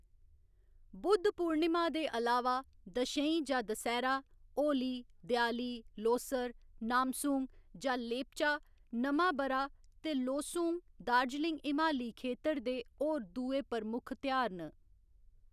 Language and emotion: Dogri, neutral